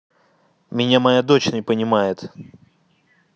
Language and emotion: Russian, angry